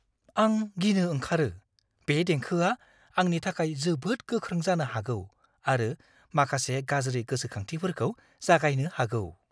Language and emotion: Bodo, fearful